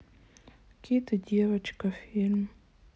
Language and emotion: Russian, sad